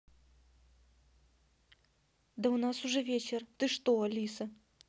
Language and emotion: Russian, neutral